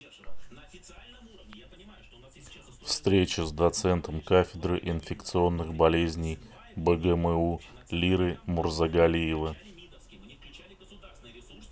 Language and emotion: Russian, neutral